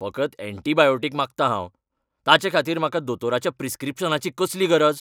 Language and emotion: Goan Konkani, angry